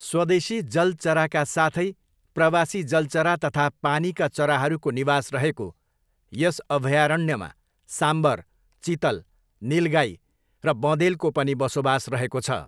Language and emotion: Nepali, neutral